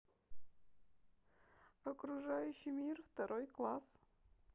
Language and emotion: Russian, sad